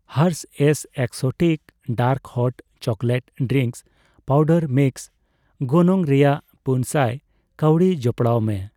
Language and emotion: Santali, neutral